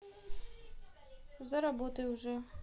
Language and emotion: Russian, neutral